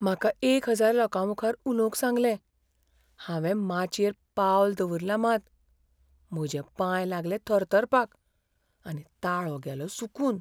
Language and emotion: Goan Konkani, fearful